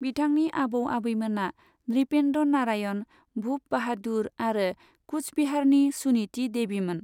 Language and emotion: Bodo, neutral